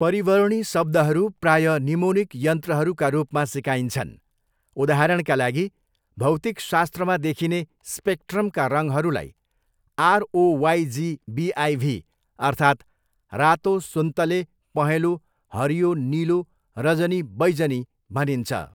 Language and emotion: Nepali, neutral